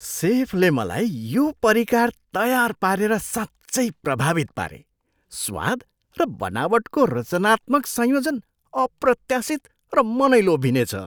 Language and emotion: Nepali, surprised